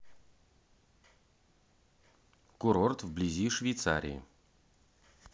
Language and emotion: Russian, neutral